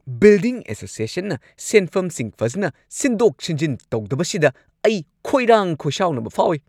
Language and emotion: Manipuri, angry